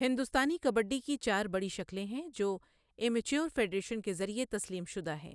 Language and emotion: Urdu, neutral